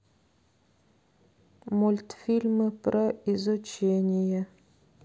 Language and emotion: Russian, neutral